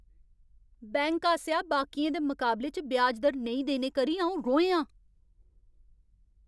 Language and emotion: Dogri, angry